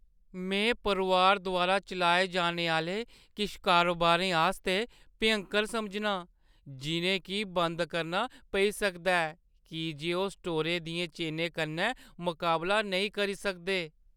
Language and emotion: Dogri, sad